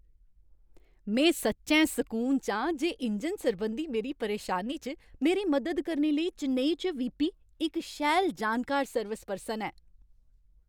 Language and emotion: Dogri, happy